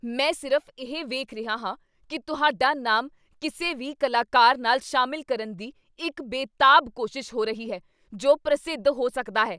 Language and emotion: Punjabi, angry